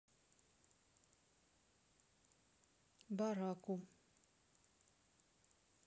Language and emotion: Russian, neutral